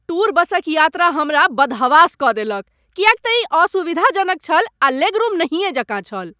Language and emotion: Maithili, angry